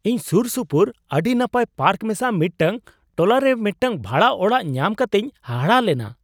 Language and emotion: Santali, surprised